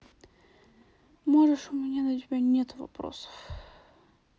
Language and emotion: Russian, sad